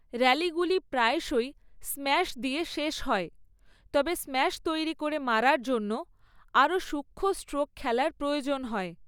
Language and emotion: Bengali, neutral